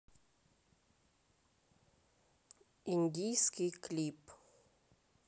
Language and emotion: Russian, neutral